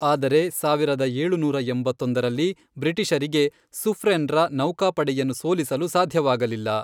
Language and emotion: Kannada, neutral